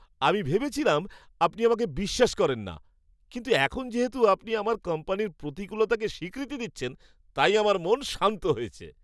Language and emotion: Bengali, happy